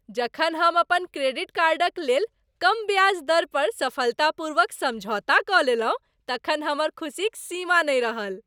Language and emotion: Maithili, happy